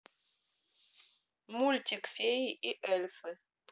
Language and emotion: Russian, neutral